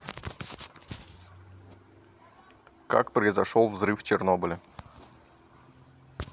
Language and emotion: Russian, neutral